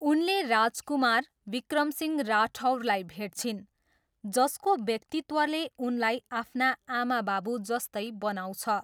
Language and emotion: Nepali, neutral